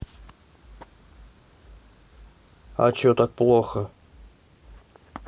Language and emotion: Russian, neutral